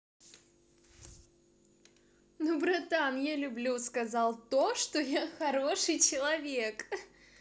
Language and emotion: Russian, positive